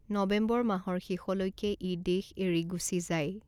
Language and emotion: Assamese, neutral